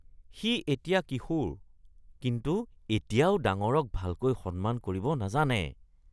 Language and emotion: Assamese, disgusted